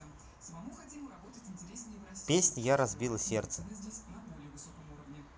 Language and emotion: Russian, neutral